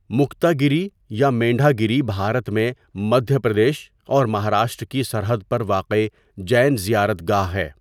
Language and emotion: Urdu, neutral